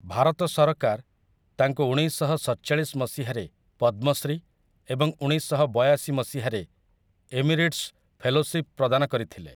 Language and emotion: Odia, neutral